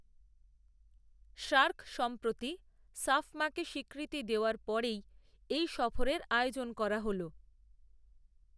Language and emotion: Bengali, neutral